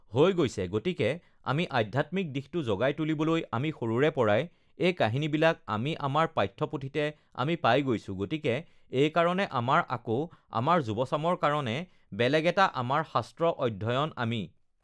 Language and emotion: Assamese, neutral